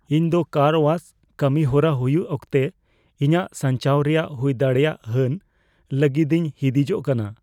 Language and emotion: Santali, fearful